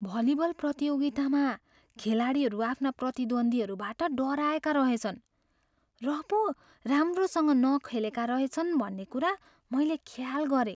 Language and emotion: Nepali, fearful